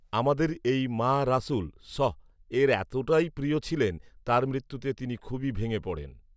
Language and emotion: Bengali, neutral